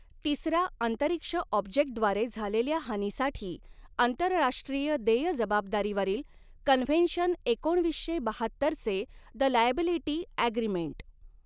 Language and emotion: Marathi, neutral